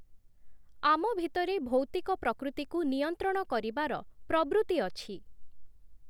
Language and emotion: Odia, neutral